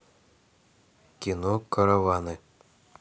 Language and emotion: Russian, neutral